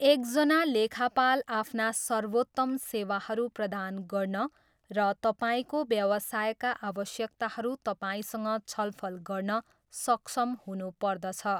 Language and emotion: Nepali, neutral